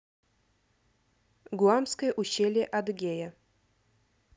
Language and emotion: Russian, neutral